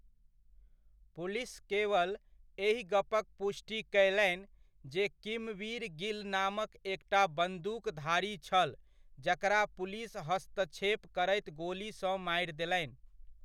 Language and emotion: Maithili, neutral